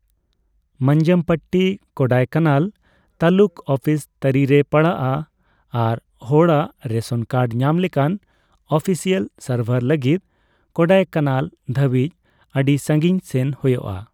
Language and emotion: Santali, neutral